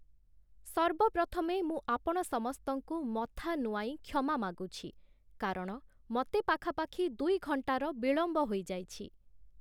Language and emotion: Odia, neutral